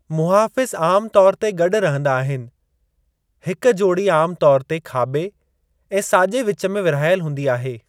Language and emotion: Sindhi, neutral